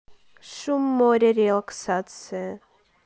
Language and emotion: Russian, neutral